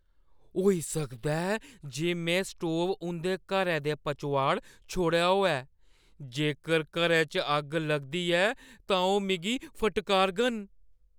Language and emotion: Dogri, fearful